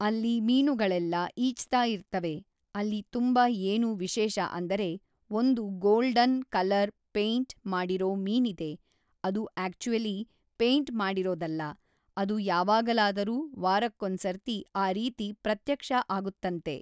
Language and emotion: Kannada, neutral